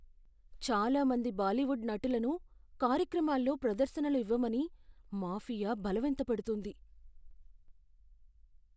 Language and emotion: Telugu, fearful